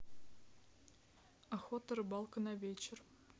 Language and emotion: Russian, neutral